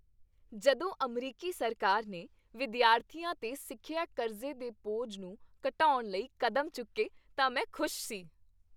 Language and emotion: Punjabi, happy